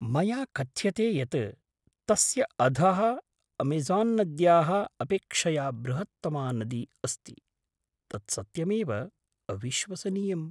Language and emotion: Sanskrit, surprised